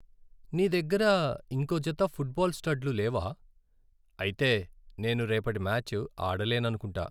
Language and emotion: Telugu, sad